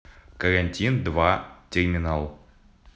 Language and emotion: Russian, neutral